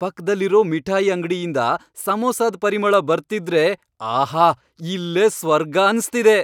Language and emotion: Kannada, happy